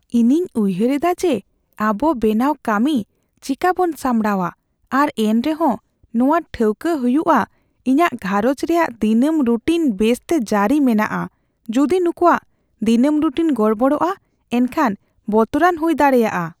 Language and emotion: Santali, fearful